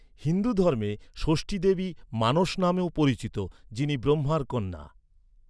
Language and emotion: Bengali, neutral